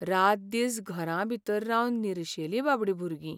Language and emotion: Goan Konkani, sad